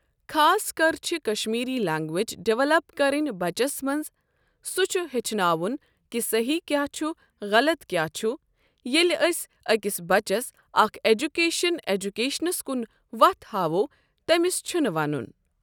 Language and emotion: Kashmiri, neutral